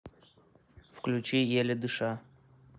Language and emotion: Russian, neutral